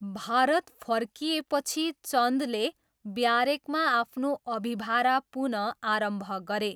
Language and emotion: Nepali, neutral